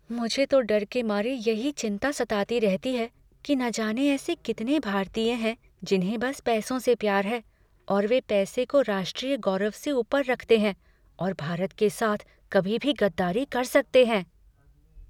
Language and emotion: Hindi, fearful